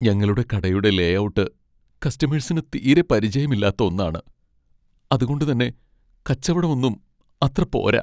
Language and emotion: Malayalam, sad